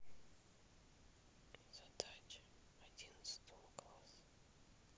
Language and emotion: Russian, neutral